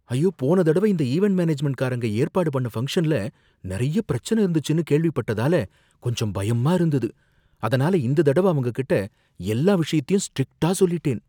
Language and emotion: Tamil, fearful